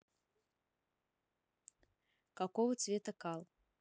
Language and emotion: Russian, neutral